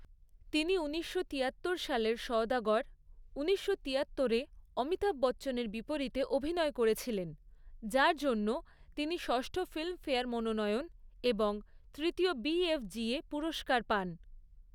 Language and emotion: Bengali, neutral